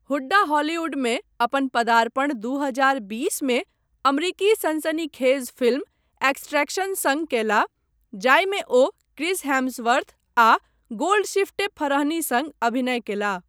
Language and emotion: Maithili, neutral